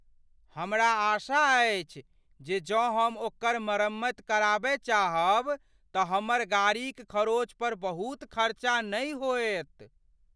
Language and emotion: Maithili, fearful